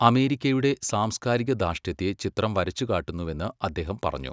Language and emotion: Malayalam, neutral